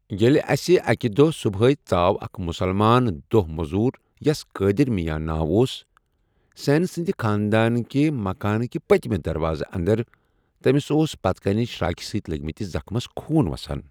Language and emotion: Kashmiri, neutral